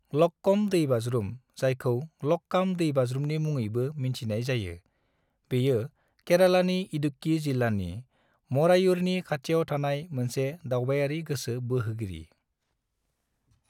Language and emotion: Bodo, neutral